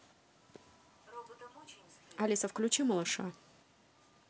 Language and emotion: Russian, neutral